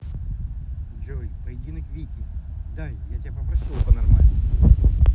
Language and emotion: Russian, angry